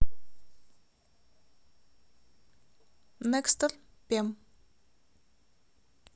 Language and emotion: Russian, neutral